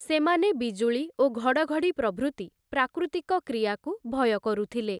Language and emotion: Odia, neutral